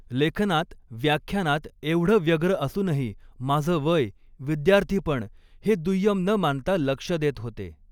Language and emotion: Marathi, neutral